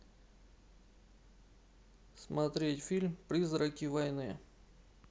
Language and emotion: Russian, neutral